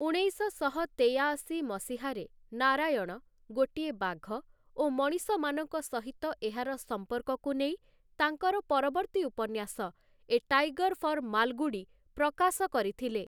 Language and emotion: Odia, neutral